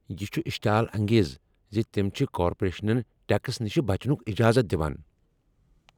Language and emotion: Kashmiri, angry